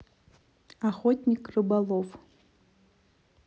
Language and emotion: Russian, neutral